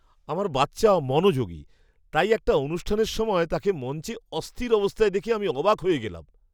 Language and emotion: Bengali, surprised